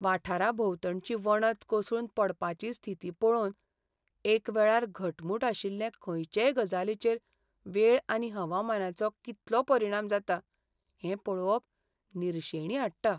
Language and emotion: Goan Konkani, sad